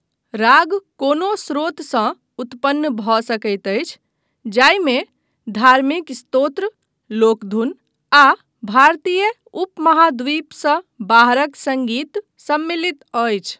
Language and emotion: Maithili, neutral